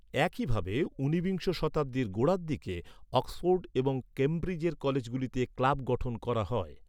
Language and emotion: Bengali, neutral